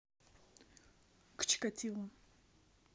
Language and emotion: Russian, neutral